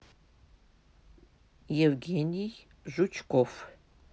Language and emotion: Russian, neutral